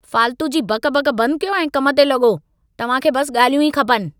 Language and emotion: Sindhi, angry